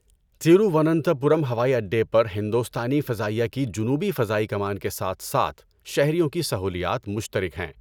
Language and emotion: Urdu, neutral